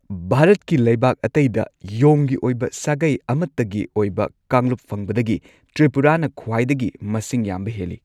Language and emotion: Manipuri, neutral